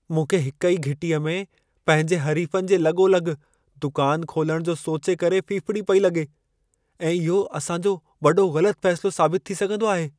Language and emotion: Sindhi, fearful